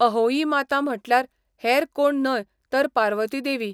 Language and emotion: Goan Konkani, neutral